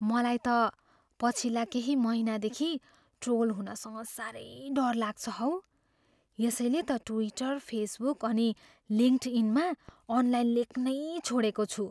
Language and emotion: Nepali, fearful